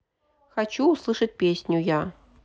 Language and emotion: Russian, neutral